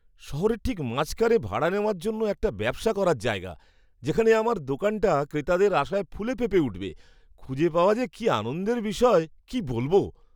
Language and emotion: Bengali, happy